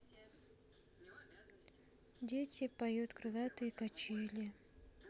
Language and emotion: Russian, sad